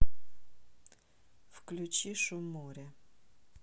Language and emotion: Russian, neutral